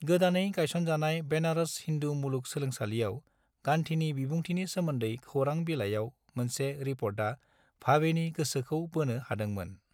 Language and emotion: Bodo, neutral